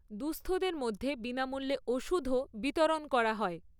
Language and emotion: Bengali, neutral